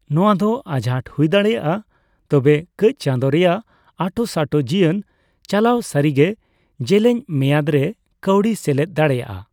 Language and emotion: Santali, neutral